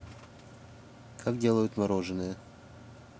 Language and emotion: Russian, neutral